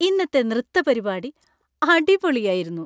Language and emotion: Malayalam, happy